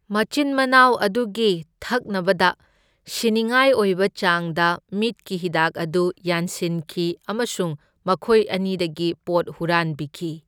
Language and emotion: Manipuri, neutral